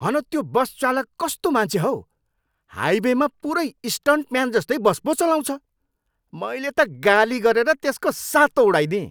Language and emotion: Nepali, angry